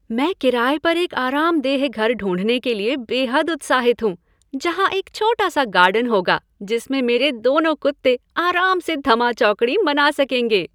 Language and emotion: Hindi, happy